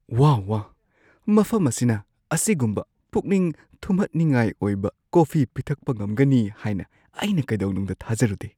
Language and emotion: Manipuri, surprised